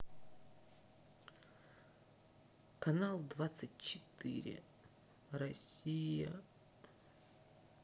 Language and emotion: Russian, sad